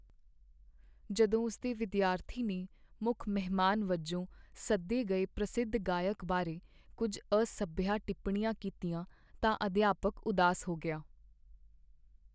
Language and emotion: Punjabi, sad